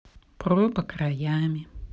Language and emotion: Russian, neutral